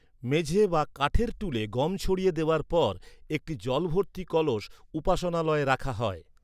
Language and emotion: Bengali, neutral